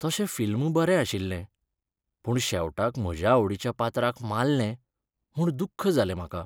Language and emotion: Goan Konkani, sad